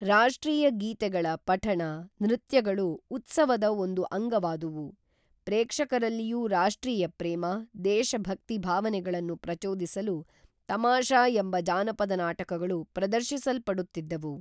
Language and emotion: Kannada, neutral